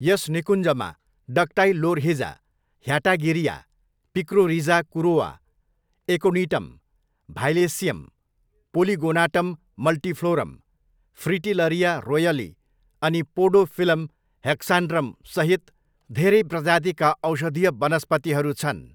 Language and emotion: Nepali, neutral